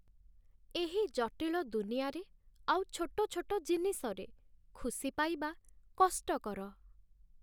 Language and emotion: Odia, sad